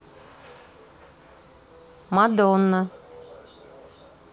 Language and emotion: Russian, neutral